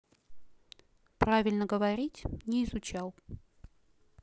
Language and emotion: Russian, neutral